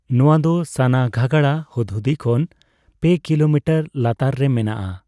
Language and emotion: Santali, neutral